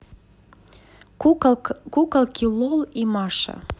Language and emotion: Russian, neutral